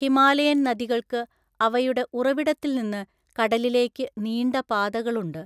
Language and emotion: Malayalam, neutral